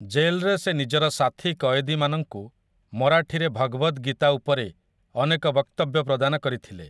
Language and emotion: Odia, neutral